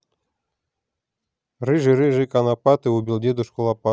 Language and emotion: Russian, positive